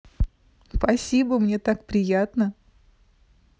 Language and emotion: Russian, positive